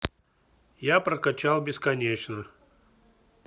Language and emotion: Russian, neutral